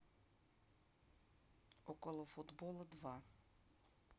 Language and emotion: Russian, neutral